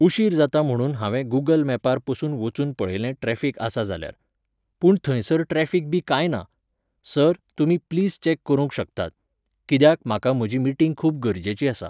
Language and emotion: Goan Konkani, neutral